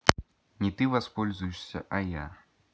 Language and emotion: Russian, neutral